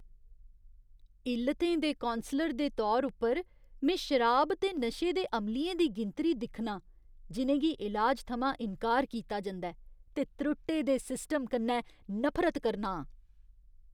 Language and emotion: Dogri, disgusted